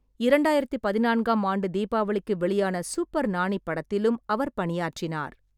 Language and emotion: Tamil, neutral